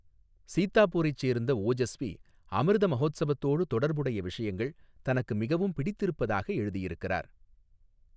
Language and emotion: Tamil, neutral